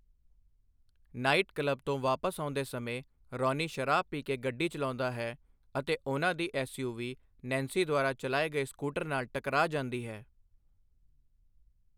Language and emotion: Punjabi, neutral